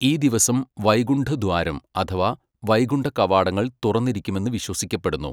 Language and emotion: Malayalam, neutral